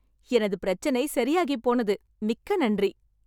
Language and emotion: Tamil, happy